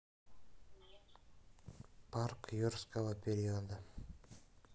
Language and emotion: Russian, neutral